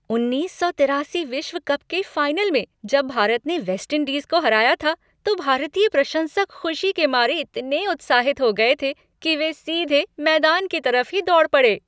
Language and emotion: Hindi, happy